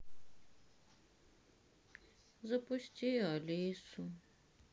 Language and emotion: Russian, sad